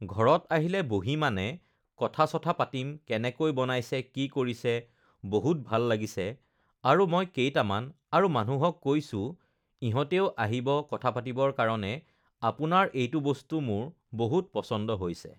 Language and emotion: Assamese, neutral